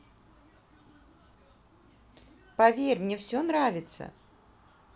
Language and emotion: Russian, positive